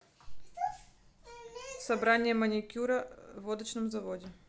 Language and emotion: Russian, neutral